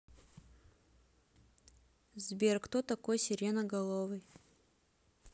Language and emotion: Russian, neutral